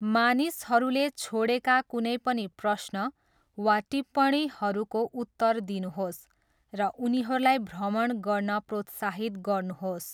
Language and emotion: Nepali, neutral